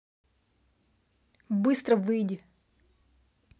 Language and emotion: Russian, angry